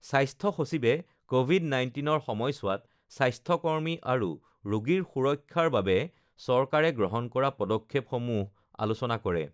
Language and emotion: Assamese, neutral